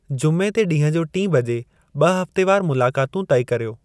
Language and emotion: Sindhi, neutral